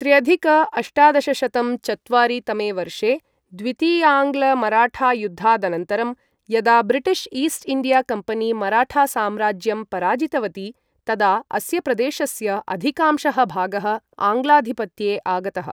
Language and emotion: Sanskrit, neutral